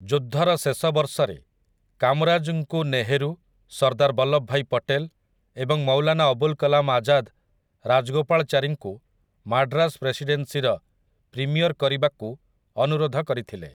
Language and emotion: Odia, neutral